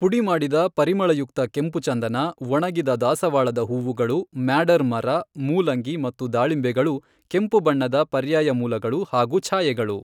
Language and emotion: Kannada, neutral